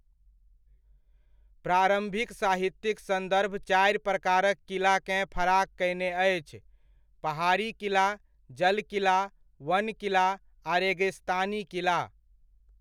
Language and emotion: Maithili, neutral